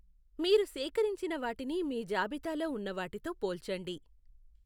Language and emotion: Telugu, neutral